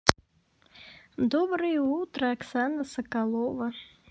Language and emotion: Russian, neutral